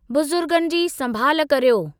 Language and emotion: Sindhi, neutral